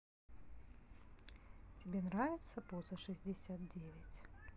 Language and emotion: Russian, neutral